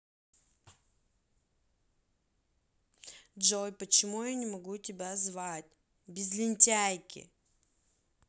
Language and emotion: Russian, angry